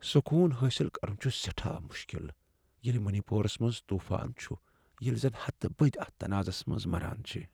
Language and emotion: Kashmiri, sad